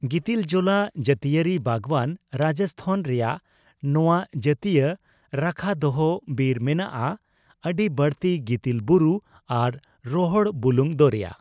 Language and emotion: Santali, neutral